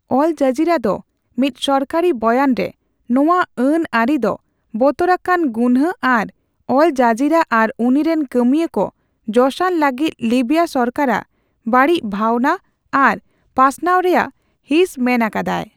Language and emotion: Santali, neutral